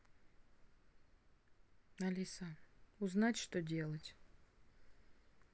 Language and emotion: Russian, sad